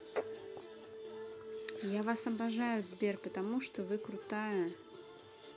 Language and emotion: Russian, neutral